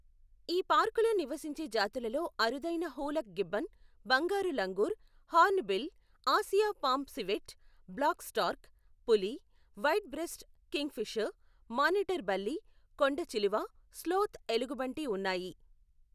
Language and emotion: Telugu, neutral